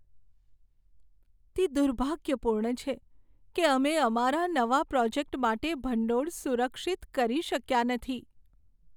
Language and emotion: Gujarati, sad